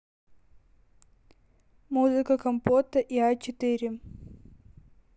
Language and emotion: Russian, neutral